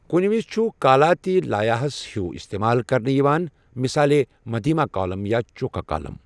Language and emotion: Kashmiri, neutral